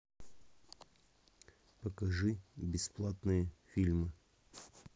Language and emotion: Russian, neutral